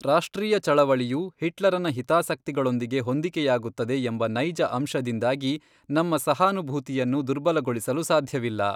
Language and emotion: Kannada, neutral